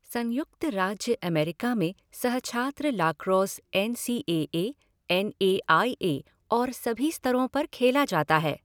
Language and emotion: Hindi, neutral